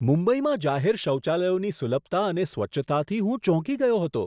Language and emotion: Gujarati, surprised